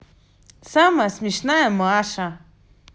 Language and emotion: Russian, positive